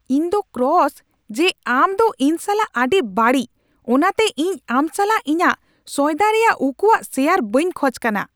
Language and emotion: Santali, angry